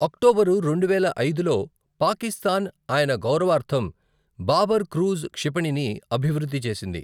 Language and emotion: Telugu, neutral